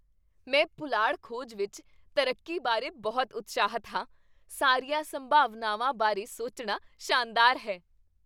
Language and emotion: Punjabi, happy